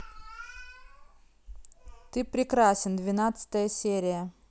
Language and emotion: Russian, neutral